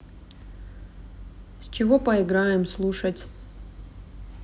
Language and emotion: Russian, neutral